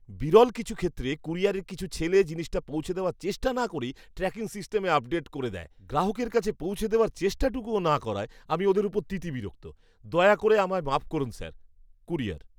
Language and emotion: Bengali, disgusted